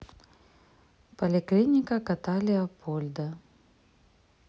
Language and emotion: Russian, neutral